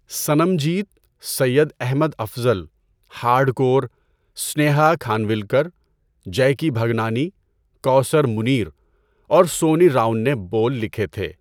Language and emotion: Urdu, neutral